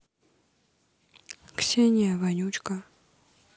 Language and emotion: Russian, neutral